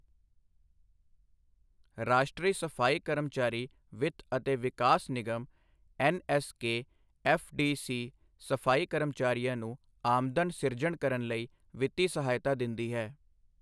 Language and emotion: Punjabi, neutral